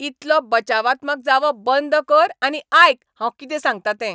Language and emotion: Goan Konkani, angry